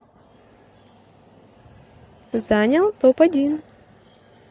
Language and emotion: Russian, positive